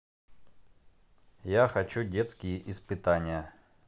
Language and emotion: Russian, neutral